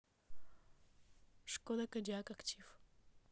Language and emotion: Russian, neutral